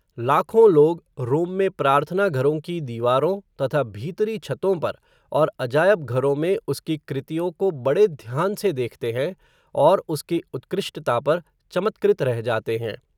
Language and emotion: Hindi, neutral